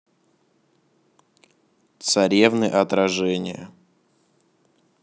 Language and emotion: Russian, neutral